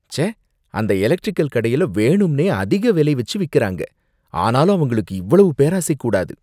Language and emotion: Tamil, disgusted